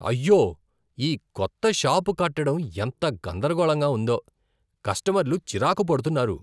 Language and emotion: Telugu, disgusted